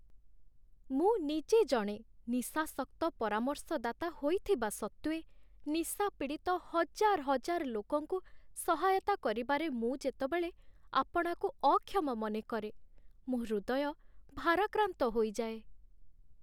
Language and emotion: Odia, sad